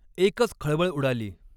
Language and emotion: Marathi, neutral